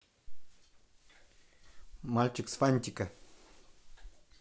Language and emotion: Russian, positive